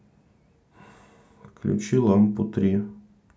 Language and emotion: Russian, neutral